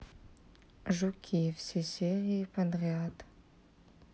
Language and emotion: Russian, sad